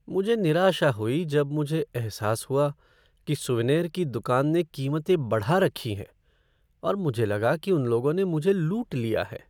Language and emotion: Hindi, sad